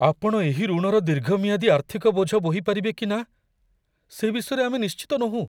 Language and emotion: Odia, fearful